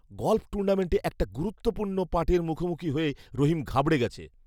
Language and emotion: Bengali, fearful